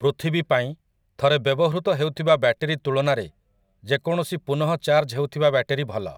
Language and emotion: Odia, neutral